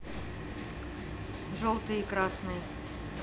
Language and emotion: Russian, neutral